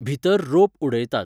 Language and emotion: Goan Konkani, neutral